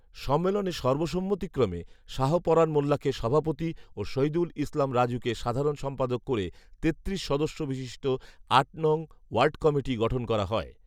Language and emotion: Bengali, neutral